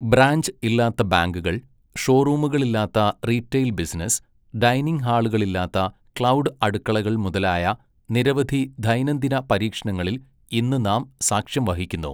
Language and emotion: Malayalam, neutral